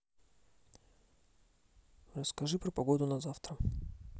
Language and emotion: Russian, neutral